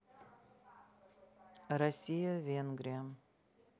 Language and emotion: Russian, neutral